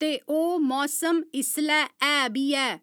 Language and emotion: Dogri, neutral